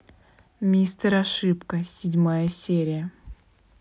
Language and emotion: Russian, neutral